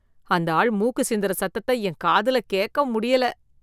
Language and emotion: Tamil, disgusted